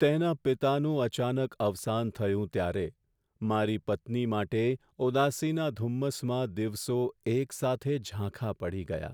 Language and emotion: Gujarati, sad